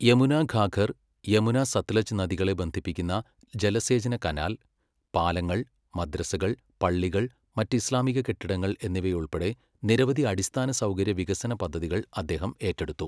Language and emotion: Malayalam, neutral